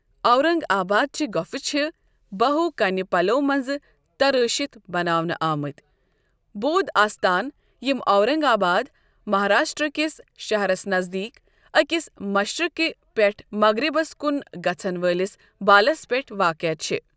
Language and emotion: Kashmiri, neutral